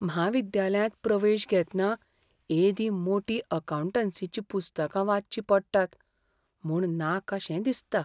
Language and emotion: Goan Konkani, fearful